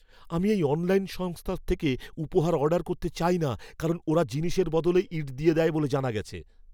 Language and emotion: Bengali, fearful